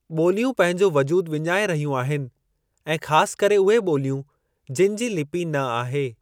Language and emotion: Sindhi, neutral